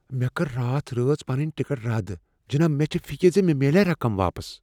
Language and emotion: Kashmiri, fearful